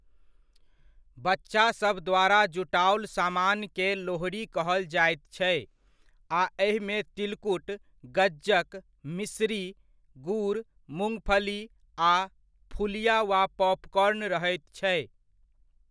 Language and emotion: Maithili, neutral